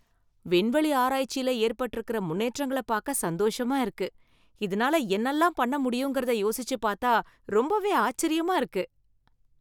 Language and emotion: Tamil, happy